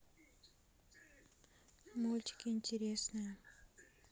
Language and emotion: Russian, neutral